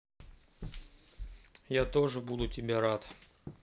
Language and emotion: Russian, neutral